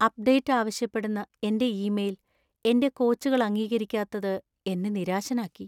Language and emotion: Malayalam, sad